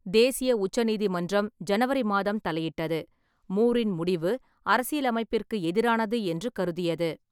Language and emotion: Tamil, neutral